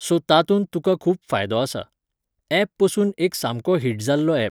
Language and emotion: Goan Konkani, neutral